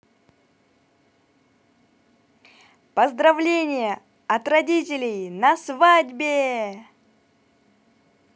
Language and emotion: Russian, positive